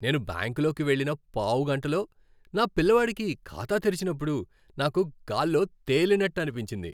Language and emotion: Telugu, happy